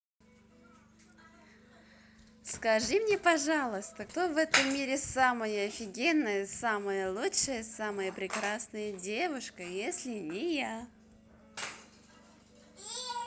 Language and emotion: Russian, positive